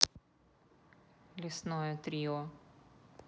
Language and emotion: Russian, neutral